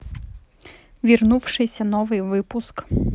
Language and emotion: Russian, neutral